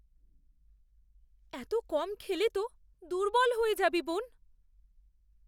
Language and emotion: Bengali, fearful